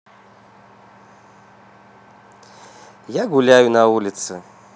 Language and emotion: Russian, positive